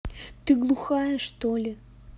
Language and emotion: Russian, angry